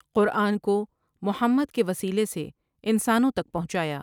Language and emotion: Urdu, neutral